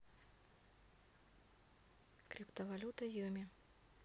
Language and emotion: Russian, neutral